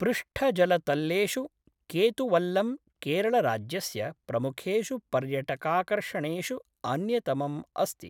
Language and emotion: Sanskrit, neutral